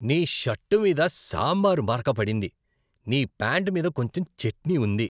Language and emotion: Telugu, disgusted